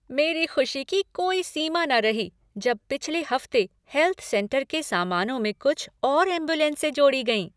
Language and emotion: Hindi, happy